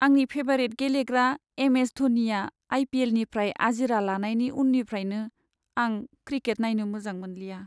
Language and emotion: Bodo, sad